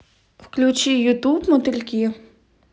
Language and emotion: Russian, neutral